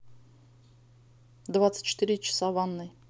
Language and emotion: Russian, neutral